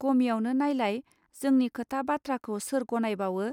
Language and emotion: Bodo, neutral